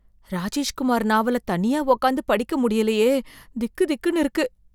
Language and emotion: Tamil, fearful